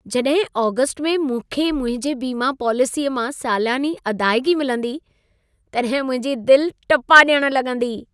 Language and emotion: Sindhi, happy